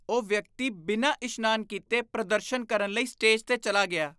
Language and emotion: Punjabi, disgusted